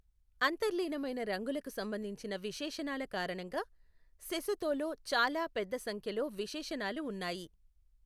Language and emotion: Telugu, neutral